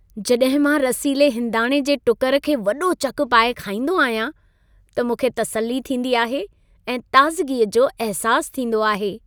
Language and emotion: Sindhi, happy